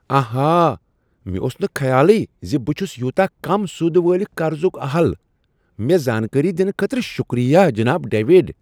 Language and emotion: Kashmiri, surprised